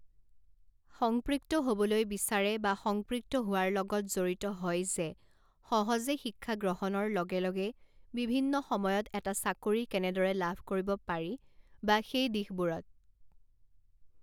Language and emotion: Assamese, neutral